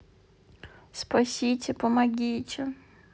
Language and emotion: Russian, sad